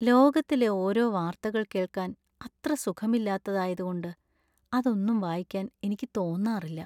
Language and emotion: Malayalam, sad